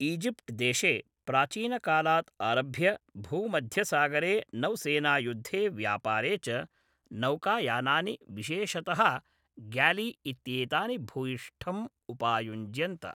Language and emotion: Sanskrit, neutral